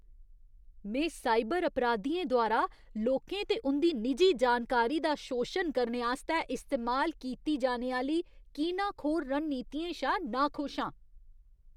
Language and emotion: Dogri, disgusted